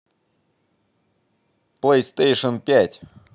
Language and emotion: Russian, positive